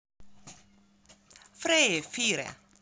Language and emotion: Russian, positive